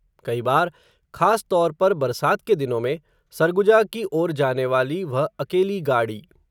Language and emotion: Hindi, neutral